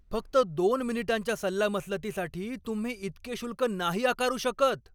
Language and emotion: Marathi, angry